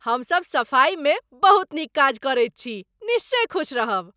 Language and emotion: Maithili, happy